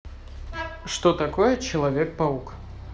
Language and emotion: Russian, neutral